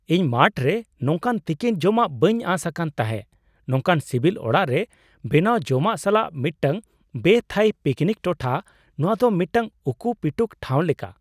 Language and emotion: Santali, surprised